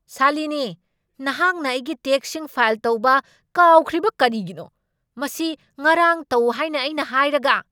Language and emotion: Manipuri, angry